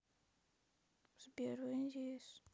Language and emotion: Russian, sad